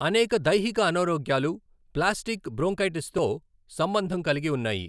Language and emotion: Telugu, neutral